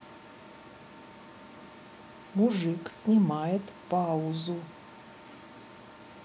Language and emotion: Russian, neutral